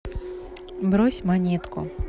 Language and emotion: Russian, neutral